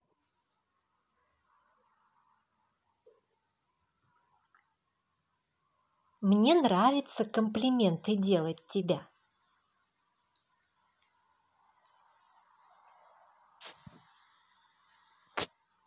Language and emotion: Russian, positive